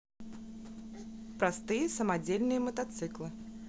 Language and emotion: Russian, neutral